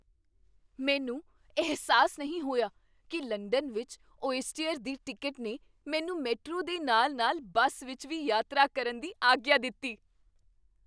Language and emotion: Punjabi, surprised